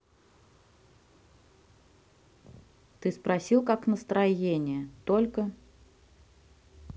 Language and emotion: Russian, neutral